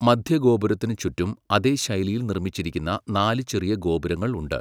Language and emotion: Malayalam, neutral